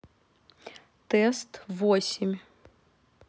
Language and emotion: Russian, neutral